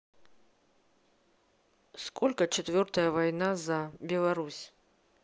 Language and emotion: Russian, neutral